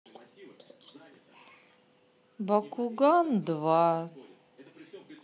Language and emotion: Russian, sad